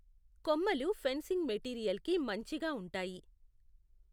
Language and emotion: Telugu, neutral